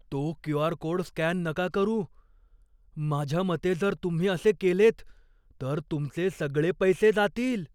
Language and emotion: Marathi, fearful